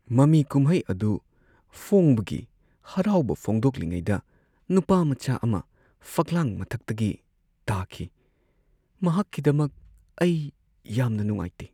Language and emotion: Manipuri, sad